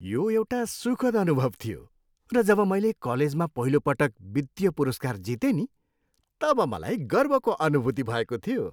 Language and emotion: Nepali, happy